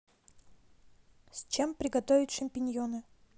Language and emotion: Russian, neutral